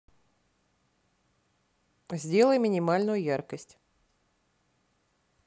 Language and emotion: Russian, neutral